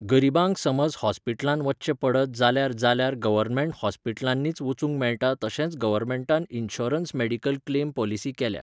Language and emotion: Goan Konkani, neutral